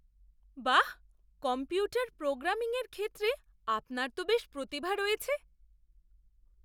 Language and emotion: Bengali, surprised